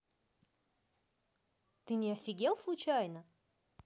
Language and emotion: Russian, neutral